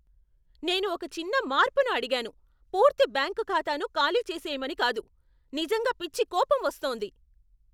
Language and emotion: Telugu, angry